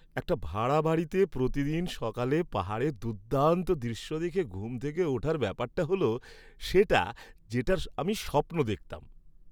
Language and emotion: Bengali, happy